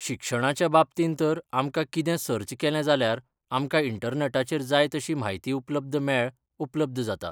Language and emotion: Goan Konkani, neutral